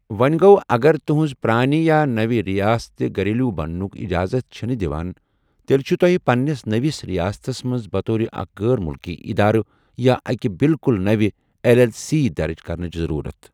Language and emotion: Kashmiri, neutral